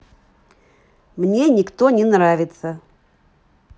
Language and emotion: Russian, neutral